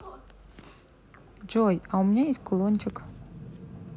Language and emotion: Russian, neutral